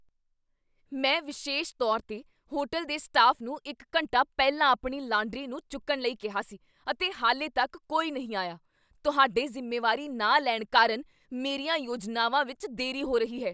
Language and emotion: Punjabi, angry